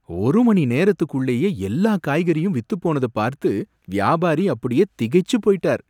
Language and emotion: Tamil, surprised